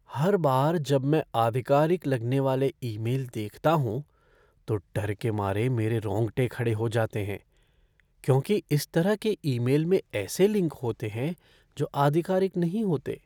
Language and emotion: Hindi, fearful